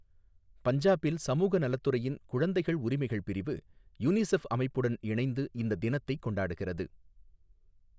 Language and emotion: Tamil, neutral